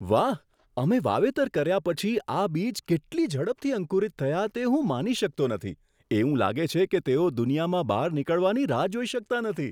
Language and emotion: Gujarati, surprised